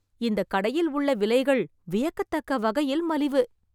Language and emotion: Tamil, surprised